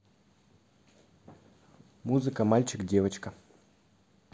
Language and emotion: Russian, neutral